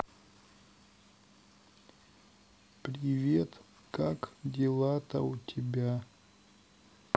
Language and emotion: Russian, sad